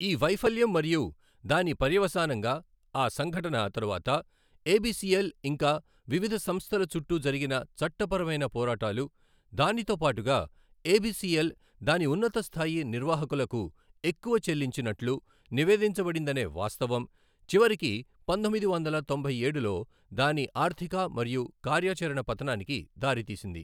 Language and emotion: Telugu, neutral